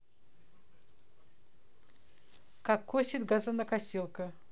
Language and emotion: Russian, neutral